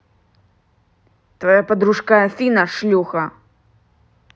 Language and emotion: Russian, angry